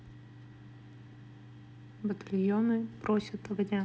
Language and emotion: Russian, neutral